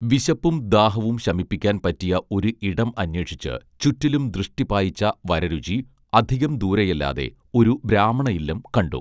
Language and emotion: Malayalam, neutral